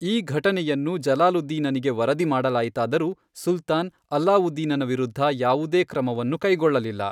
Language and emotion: Kannada, neutral